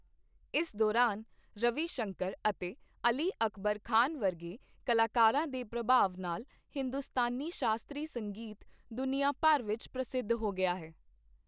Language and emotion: Punjabi, neutral